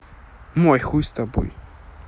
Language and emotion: Russian, neutral